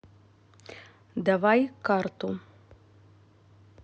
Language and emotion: Russian, neutral